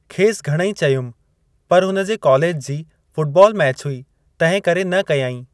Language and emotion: Sindhi, neutral